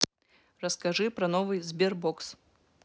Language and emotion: Russian, neutral